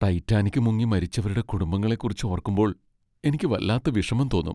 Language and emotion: Malayalam, sad